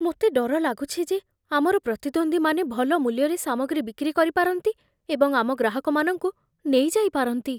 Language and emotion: Odia, fearful